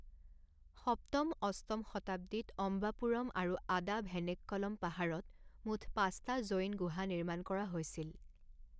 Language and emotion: Assamese, neutral